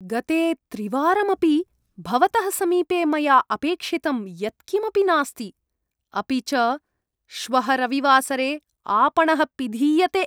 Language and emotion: Sanskrit, disgusted